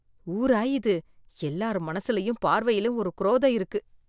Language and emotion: Tamil, disgusted